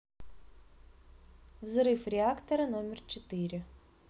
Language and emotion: Russian, neutral